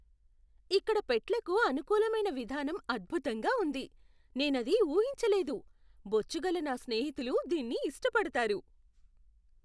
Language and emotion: Telugu, surprised